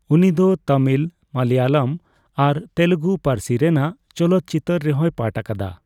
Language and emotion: Santali, neutral